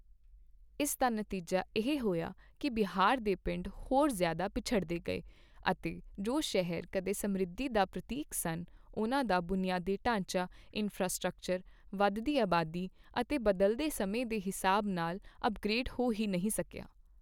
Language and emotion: Punjabi, neutral